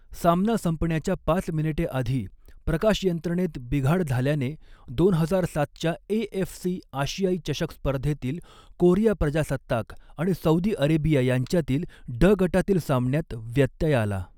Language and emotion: Marathi, neutral